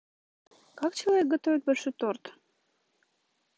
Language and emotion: Russian, neutral